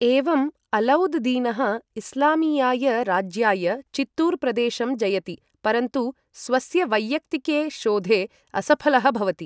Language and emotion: Sanskrit, neutral